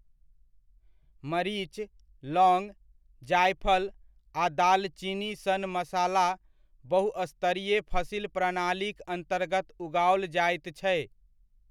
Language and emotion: Maithili, neutral